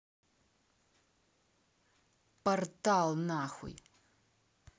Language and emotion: Russian, angry